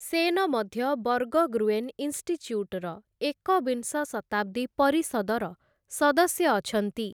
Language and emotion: Odia, neutral